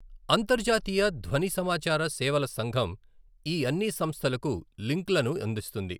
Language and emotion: Telugu, neutral